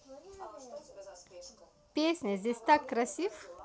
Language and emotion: Russian, positive